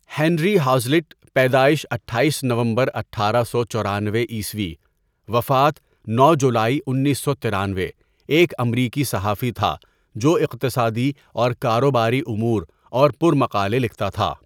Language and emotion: Urdu, neutral